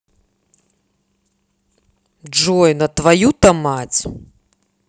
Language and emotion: Russian, angry